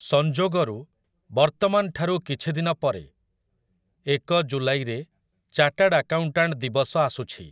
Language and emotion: Odia, neutral